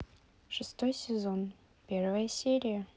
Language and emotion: Russian, neutral